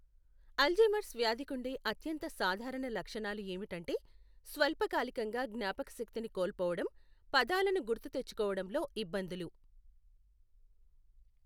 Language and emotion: Telugu, neutral